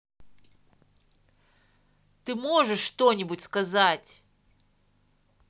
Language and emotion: Russian, angry